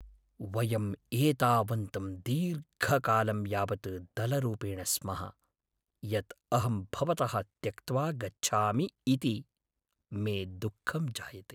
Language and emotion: Sanskrit, sad